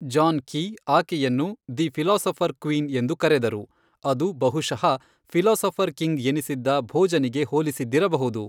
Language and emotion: Kannada, neutral